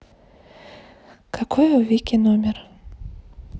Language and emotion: Russian, neutral